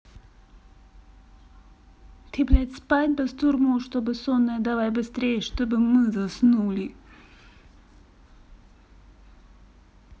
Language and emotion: Russian, angry